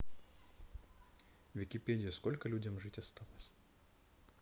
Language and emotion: Russian, neutral